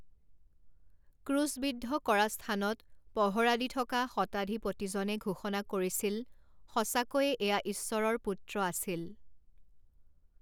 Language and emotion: Assamese, neutral